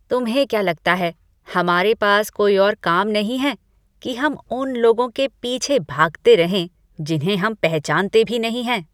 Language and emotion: Hindi, disgusted